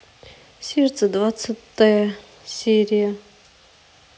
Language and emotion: Russian, neutral